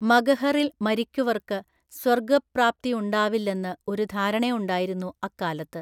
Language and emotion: Malayalam, neutral